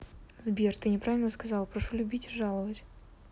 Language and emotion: Russian, neutral